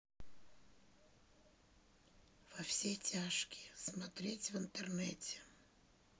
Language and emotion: Russian, sad